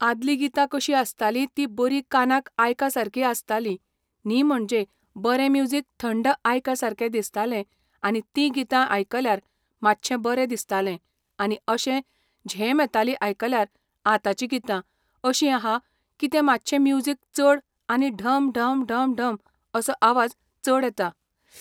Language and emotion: Goan Konkani, neutral